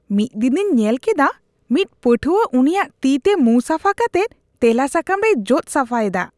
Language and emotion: Santali, disgusted